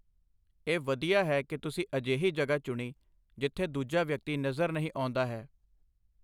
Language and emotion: Punjabi, neutral